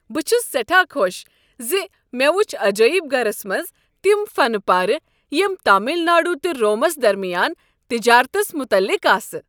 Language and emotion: Kashmiri, happy